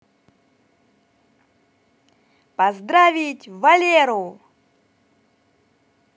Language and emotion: Russian, positive